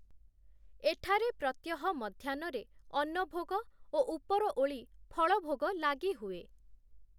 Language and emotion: Odia, neutral